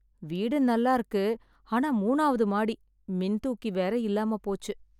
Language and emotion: Tamil, sad